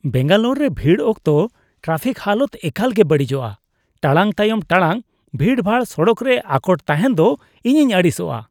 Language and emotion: Santali, disgusted